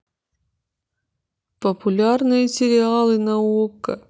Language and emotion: Russian, neutral